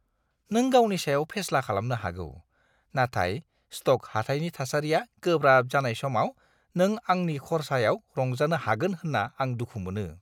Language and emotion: Bodo, disgusted